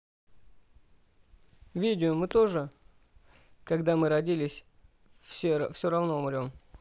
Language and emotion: Russian, neutral